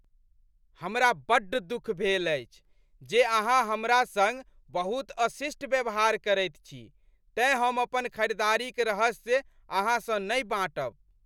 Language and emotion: Maithili, angry